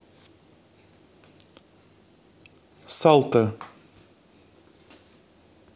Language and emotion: Russian, neutral